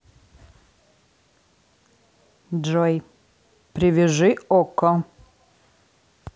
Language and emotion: Russian, neutral